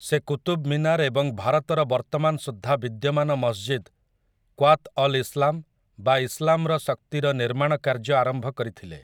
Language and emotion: Odia, neutral